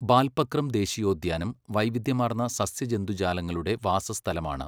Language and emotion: Malayalam, neutral